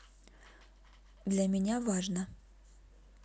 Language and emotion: Russian, neutral